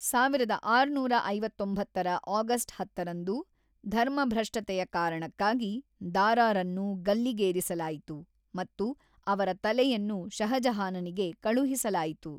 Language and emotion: Kannada, neutral